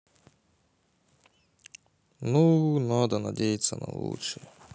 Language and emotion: Russian, sad